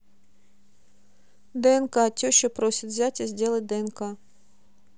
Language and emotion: Russian, neutral